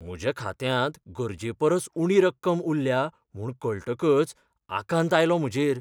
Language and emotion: Goan Konkani, fearful